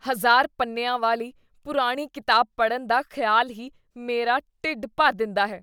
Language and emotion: Punjabi, disgusted